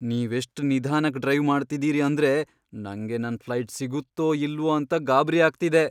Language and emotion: Kannada, fearful